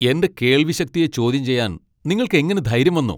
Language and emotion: Malayalam, angry